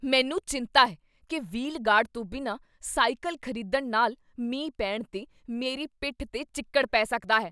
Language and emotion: Punjabi, fearful